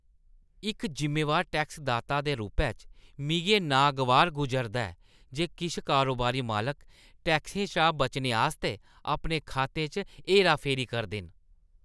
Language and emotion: Dogri, disgusted